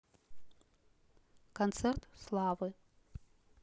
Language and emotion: Russian, neutral